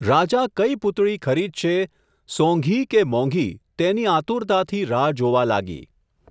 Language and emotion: Gujarati, neutral